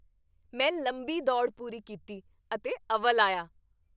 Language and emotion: Punjabi, happy